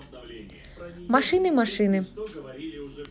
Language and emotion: Russian, neutral